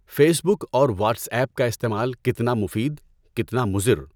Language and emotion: Urdu, neutral